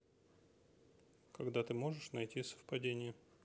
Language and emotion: Russian, neutral